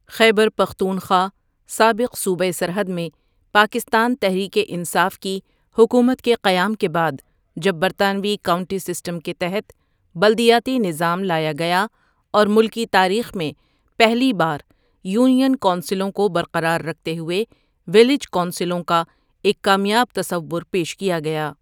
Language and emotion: Urdu, neutral